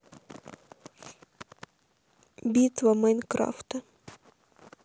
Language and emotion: Russian, sad